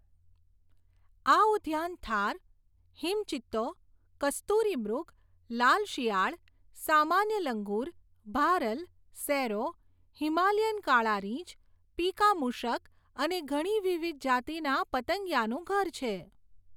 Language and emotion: Gujarati, neutral